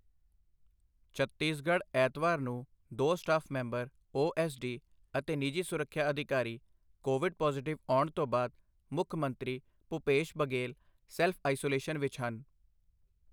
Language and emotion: Punjabi, neutral